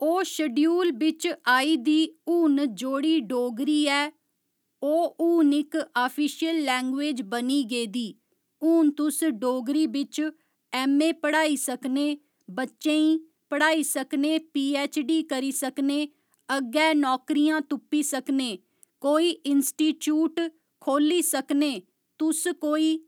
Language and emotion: Dogri, neutral